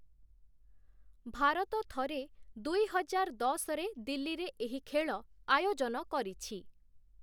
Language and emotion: Odia, neutral